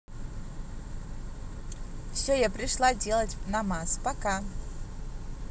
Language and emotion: Russian, positive